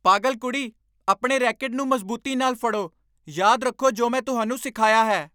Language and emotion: Punjabi, angry